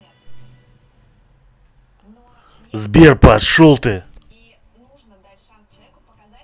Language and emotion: Russian, angry